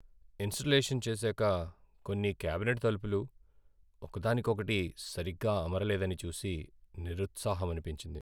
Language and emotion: Telugu, sad